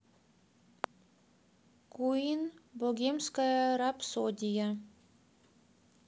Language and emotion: Russian, neutral